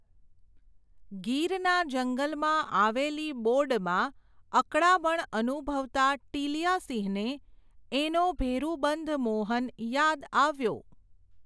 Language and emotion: Gujarati, neutral